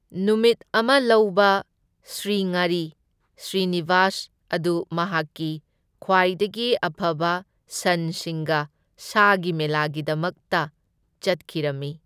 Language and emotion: Manipuri, neutral